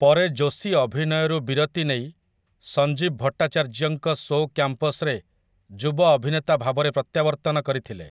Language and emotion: Odia, neutral